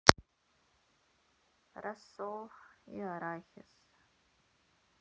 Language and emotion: Russian, sad